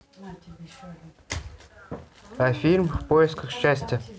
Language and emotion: Russian, neutral